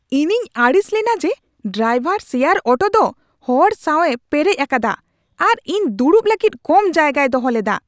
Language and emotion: Santali, angry